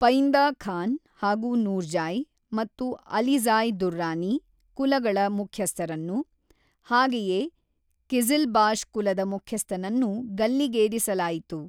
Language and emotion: Kannada, neutral